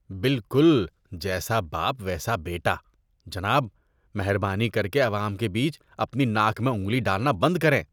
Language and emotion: Urdu, disgusted